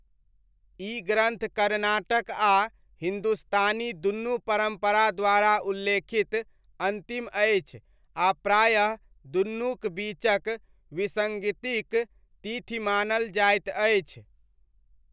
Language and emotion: Maithili, neutral